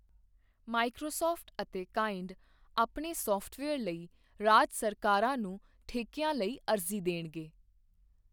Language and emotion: Punjabi, neutral